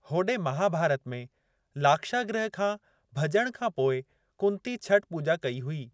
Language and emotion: Sindhi, neutral